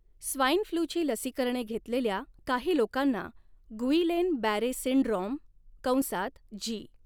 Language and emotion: Marathi, neutral